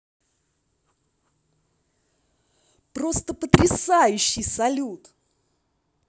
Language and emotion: Russian, positive